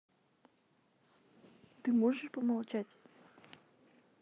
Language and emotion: Russian, neutral